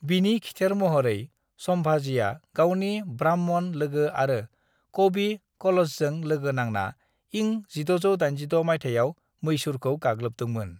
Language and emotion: Bodo, neutral